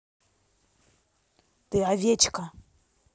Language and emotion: Russian, angry